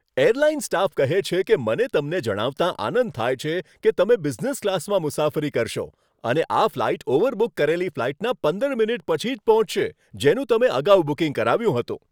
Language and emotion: Gujarati, happy